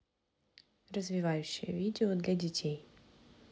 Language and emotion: Russian, neutral